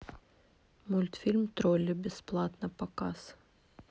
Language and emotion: Russian, neutral